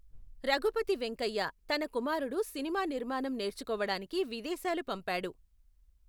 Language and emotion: Telugu, neutral